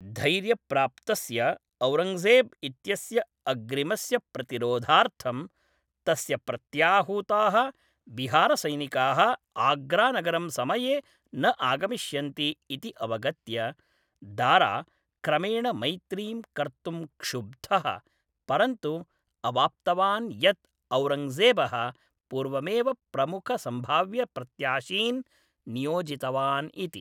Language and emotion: Sanskrit, neutral